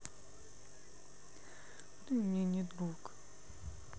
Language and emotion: Russian, sad